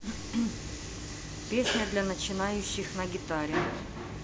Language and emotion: Russian, neutral